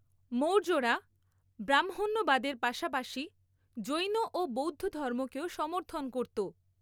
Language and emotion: Bengali, neutral